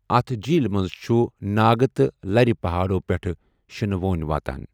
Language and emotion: Kashmiri, neutral